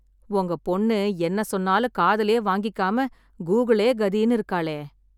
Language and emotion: Tamil, sad